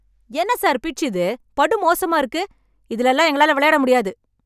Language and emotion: Tamil, angry